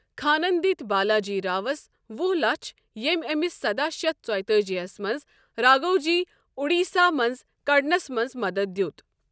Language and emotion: Kashmiri, neutral